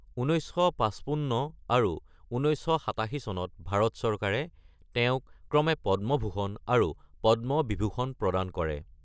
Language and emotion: Assamese, neutral